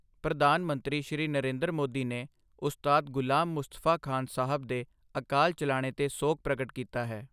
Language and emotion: Punjabi, neutral